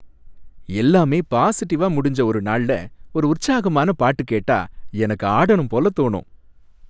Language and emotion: Tamil, happy